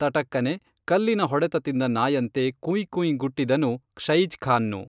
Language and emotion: Kannada, neutral